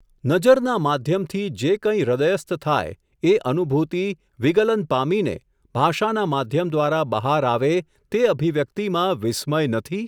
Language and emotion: Gujarati, neutral